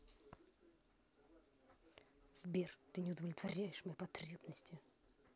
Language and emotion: Russian, angry